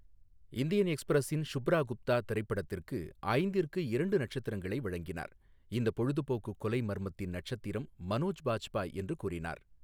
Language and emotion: Tamil, neutral